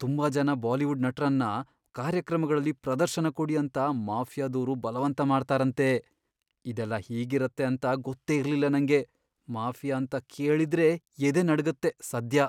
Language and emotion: Kannada, fearful